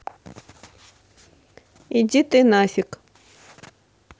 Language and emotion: Russian, neutral